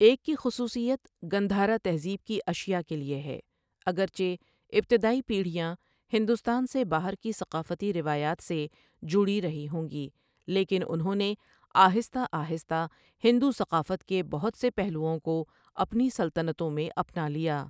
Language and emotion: Urdu, neutral